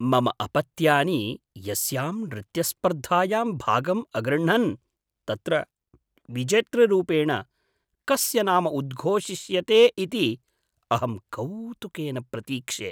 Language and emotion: Sanskrit, surprised